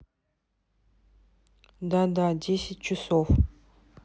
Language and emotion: Russian, neutral